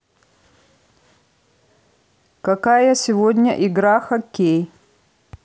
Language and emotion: Russian, neutral